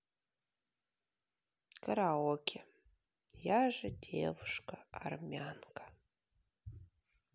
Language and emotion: Russian, sad